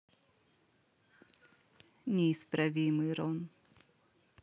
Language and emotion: Russian, neutral